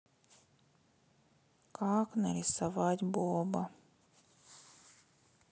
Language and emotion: Russian, sad